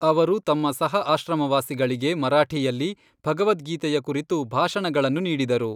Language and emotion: Kannada, neutral